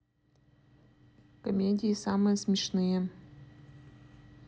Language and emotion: Russian, neutral